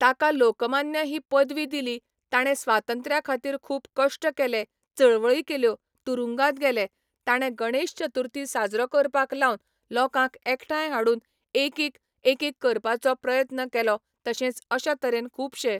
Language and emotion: Goan Konkani, neutral